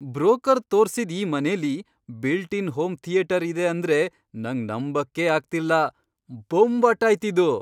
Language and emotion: Kannada, surprised